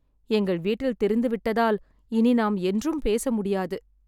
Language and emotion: Tamil, sad